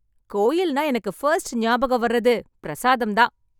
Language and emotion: Tamil, happy